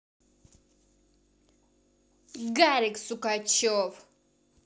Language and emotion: Russian, angry